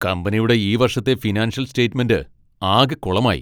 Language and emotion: Malayalam, angry